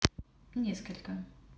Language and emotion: Russian, neutral